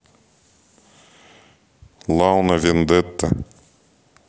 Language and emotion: Russian, neutral